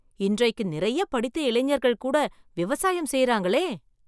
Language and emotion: Tamil, surprised